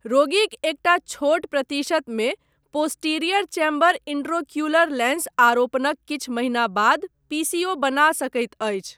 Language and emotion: Maithili, neutral